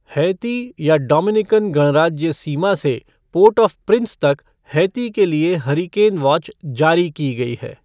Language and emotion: Hindi, neutral